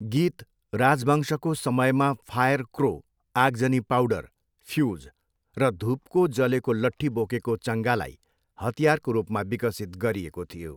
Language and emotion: Nepali, neutral